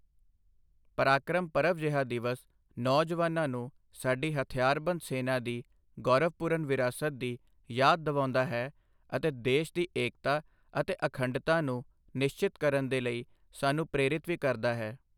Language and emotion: Punjabi, neutral